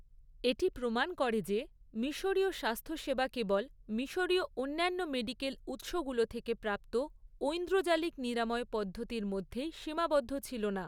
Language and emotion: Bengali, neutral